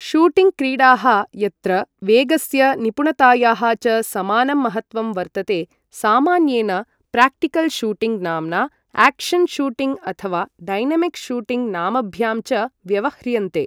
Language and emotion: Sanskrit, neutral